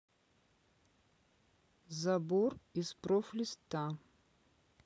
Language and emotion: Russian, neutral